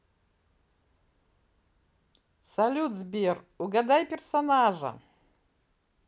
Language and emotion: Russian, positive